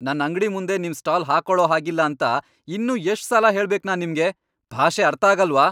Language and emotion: Kannada, angry